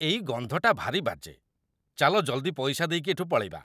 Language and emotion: Odia, disgusted